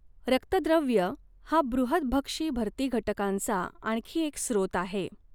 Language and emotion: Marathi, neutral